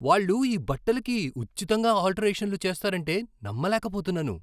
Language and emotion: Telugu, surprised